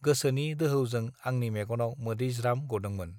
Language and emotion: Bodo, neutral